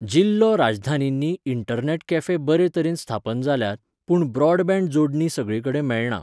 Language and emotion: Goan Konkani, neutral